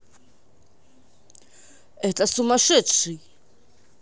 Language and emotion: Russian, angry